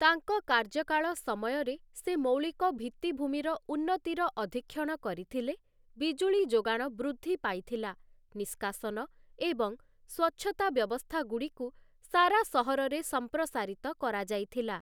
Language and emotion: Odia, neutral